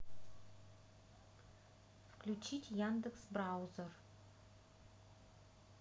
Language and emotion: Russian, neutral